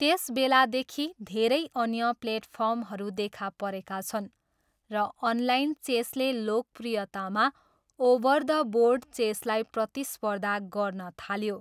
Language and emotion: Nepali, neutral